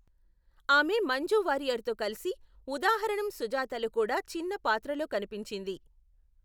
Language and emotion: Telugu, neutral